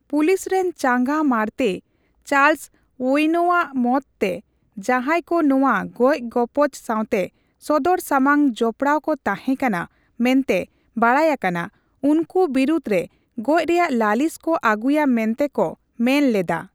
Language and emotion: Santali, neutral